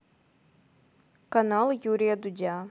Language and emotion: Russian, neutral